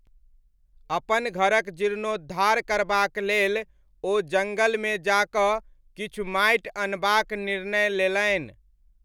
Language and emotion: Maithili, neutral